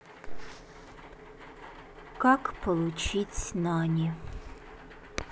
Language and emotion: Russian, sad